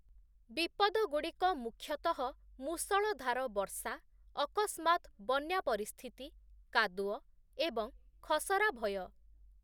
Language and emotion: Odia, neutral